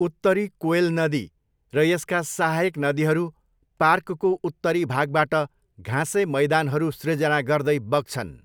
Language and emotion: Nepali, neutral